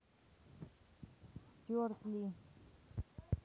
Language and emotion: Russian, neutral